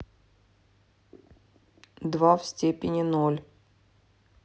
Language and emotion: Russian, neutral